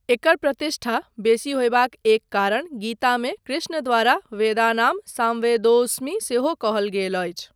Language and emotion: Maithili, neutral